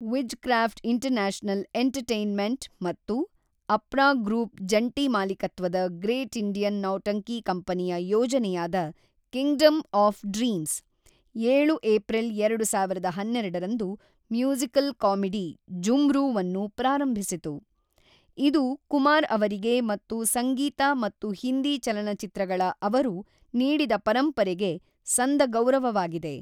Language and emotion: Kannada, neutral